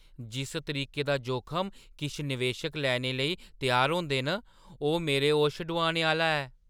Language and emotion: Dogri, surprised